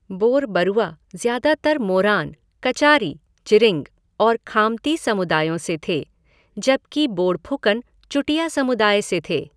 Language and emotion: Hindi, neutral